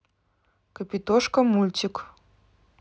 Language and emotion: Russian, neutral